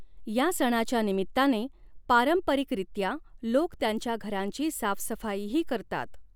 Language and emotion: Marathi, neutral